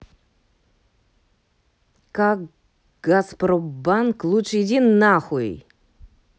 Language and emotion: Russian, angry